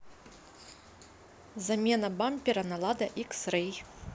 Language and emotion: Russian, neutral